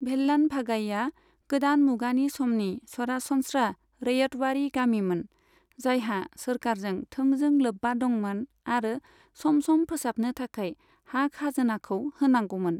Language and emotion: Bodo, neutral